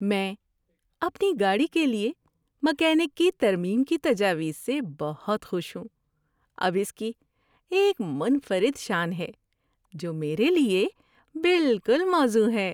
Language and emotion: Urdu, happy